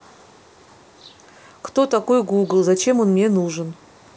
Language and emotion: Russian, neutral